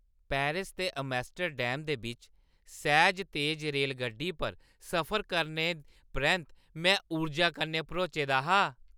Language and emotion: Dogri, happy